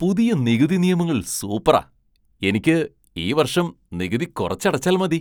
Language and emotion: Malayalam, surprised